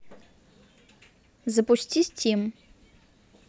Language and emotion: Russian, neutral